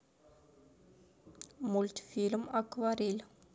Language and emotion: Russian, neutral